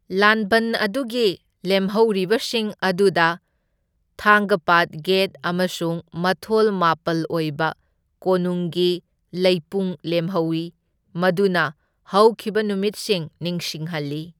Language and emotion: Manipuri, neutral